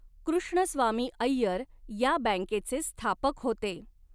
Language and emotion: Marathi, neutral